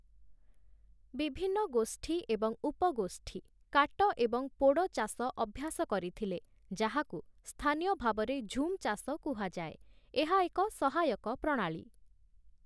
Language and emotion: Odia, neutral